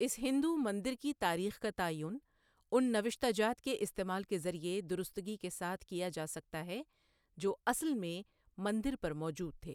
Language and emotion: Urdu, neutral